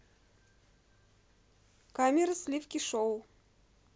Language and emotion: Russian, neutral